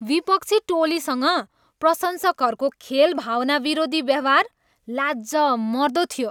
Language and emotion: Nepali, disgusted